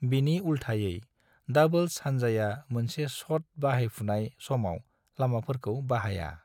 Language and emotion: Bodo, neutral